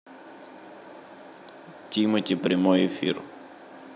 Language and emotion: Russian, neutral